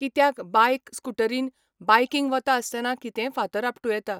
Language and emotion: Goan Konkani, neutral